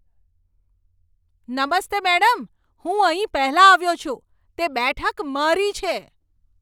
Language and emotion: Gujarati, angry